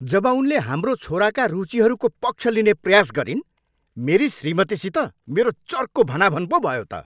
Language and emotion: Nepali, angry